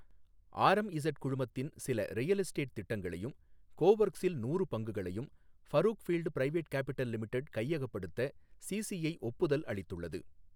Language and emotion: Tamil, neutral